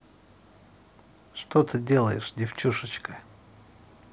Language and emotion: Russian, positive